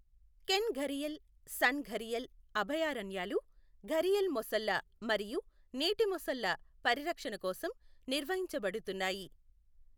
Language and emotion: Telugu, neutral